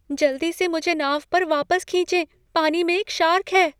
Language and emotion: Hindi, fearful